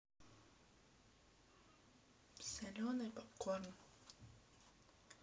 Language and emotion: Russian, neutral